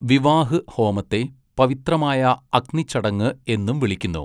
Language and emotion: Malayalam, neutral